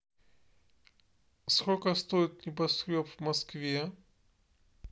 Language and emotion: Russian, neutral